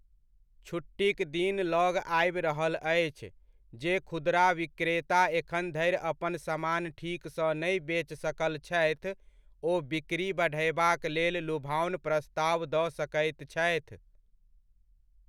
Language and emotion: Maithili, neutral